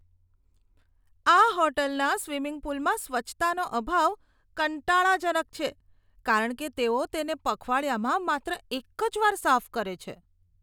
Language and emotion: Gujarati, disgusted